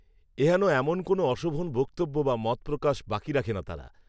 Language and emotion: Bengali, neutral